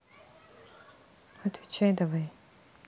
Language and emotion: Russian, neutral